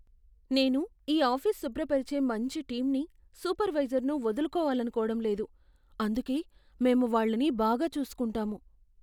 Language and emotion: Telugu, fearful